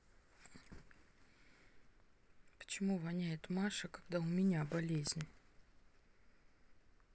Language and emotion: Russian, sad